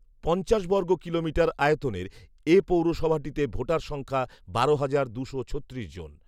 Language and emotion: Bengali, neutral